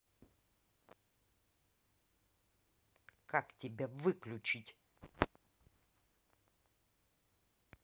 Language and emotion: Russian, angry